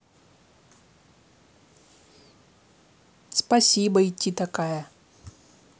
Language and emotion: Russian, neutral